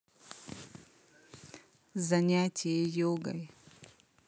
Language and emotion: Russian, neutral